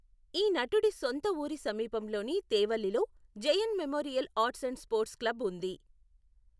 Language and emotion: Telugu, neutral